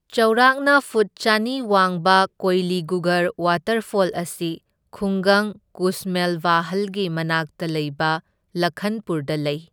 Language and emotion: Manipuri, neutral